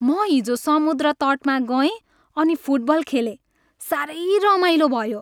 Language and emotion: Nepali, happy